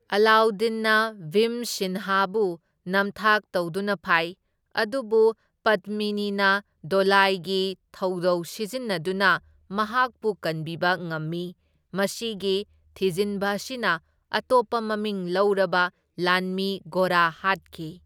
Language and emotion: Manipuri, neutral